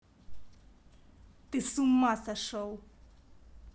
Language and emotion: Russian, angry